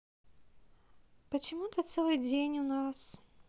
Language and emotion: Russian, sad